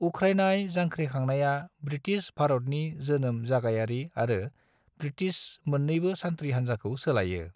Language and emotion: Bodo, neutral